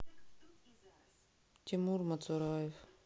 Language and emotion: Russian, sad